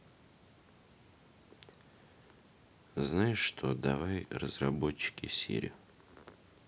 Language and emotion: Russian, neutral